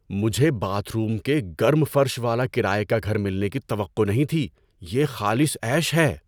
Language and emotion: Urdu, surprised